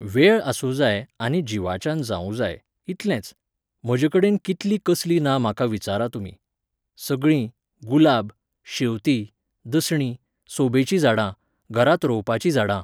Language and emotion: Goan Konkani, neutral